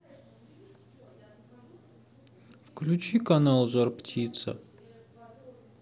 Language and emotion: Russian, sad